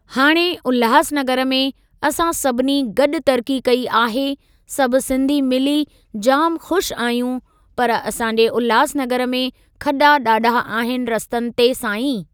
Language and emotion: Sindhi, neutral